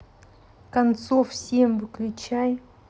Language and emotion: Russian, neutral